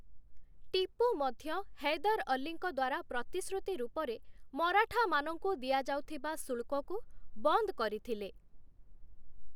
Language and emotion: Odia, neutral